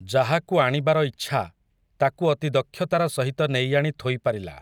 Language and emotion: Odia, neutral